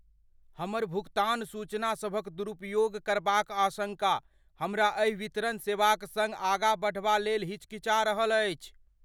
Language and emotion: Maithili, fearful